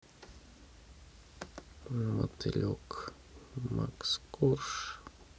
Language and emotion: Russian, sad